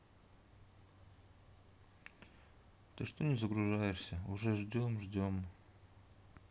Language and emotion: Russian, sad